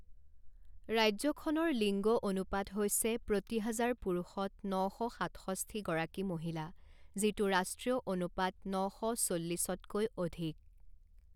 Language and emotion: Assamese, neutral